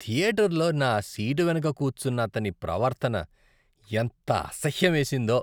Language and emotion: Telugu, disgusted